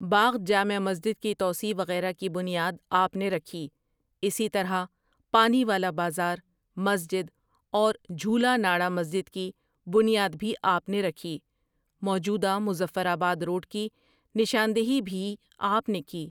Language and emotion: Urdu, neutral